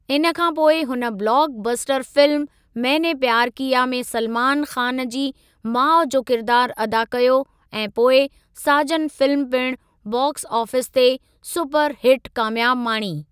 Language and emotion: Sindhi, neutral